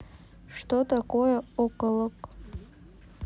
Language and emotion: Russian, neutral